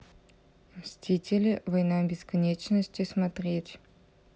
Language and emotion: Russian, neutral